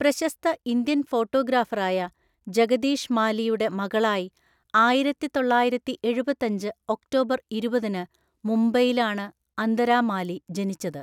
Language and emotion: Malayalam, neutral